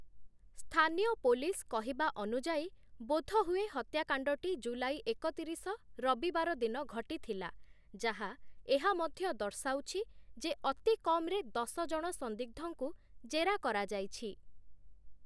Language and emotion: Odia, neutral